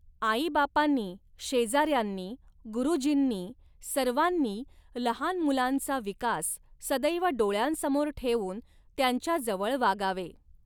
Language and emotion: Marathi, neutral